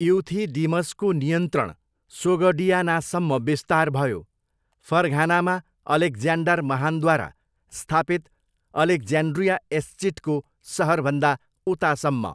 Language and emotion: Nepali, neutral